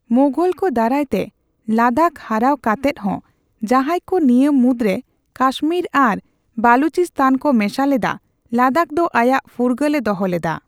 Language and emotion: Santali, neutral